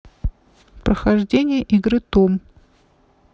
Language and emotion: Russian, neutral